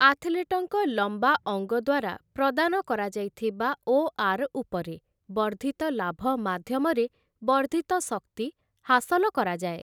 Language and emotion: Odia, neutral